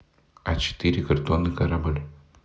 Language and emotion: Russian, neutral